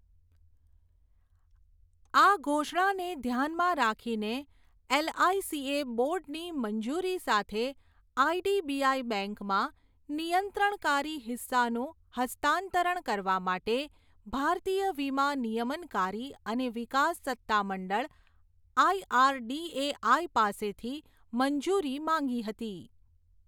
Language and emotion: Gujarati, neutral